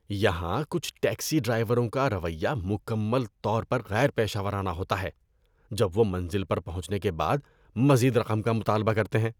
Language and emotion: Urdu, disgusted